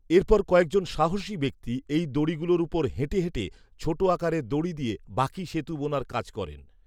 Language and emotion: Bengali, neutral